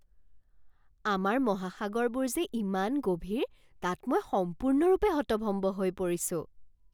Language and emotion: Assamese, surprised